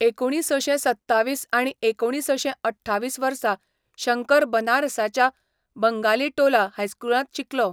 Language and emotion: Goan Konkani, neutral